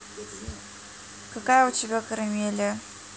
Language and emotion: Russian, neutral